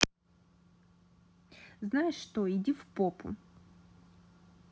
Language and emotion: Russian, angry